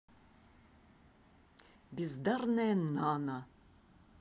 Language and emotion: Russian, angry